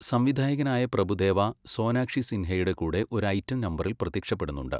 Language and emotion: Malayalam, neutral